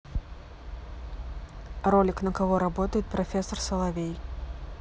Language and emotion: Russian, neutral